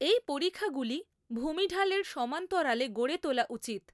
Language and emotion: Bengali, neutral